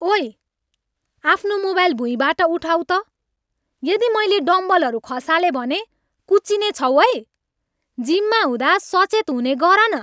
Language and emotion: Nepali, angry